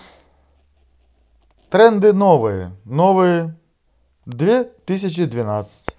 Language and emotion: Russian, positive